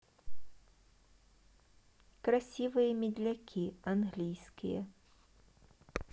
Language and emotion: Russian, neutral